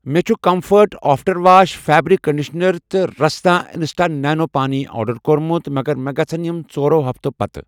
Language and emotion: Kashmiri, neutral